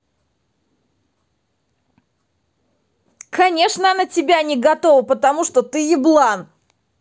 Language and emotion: Russian, angry